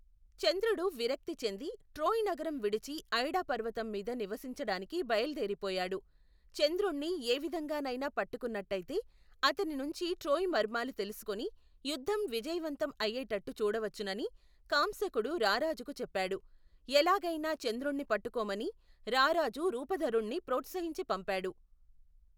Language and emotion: Telugu, neutral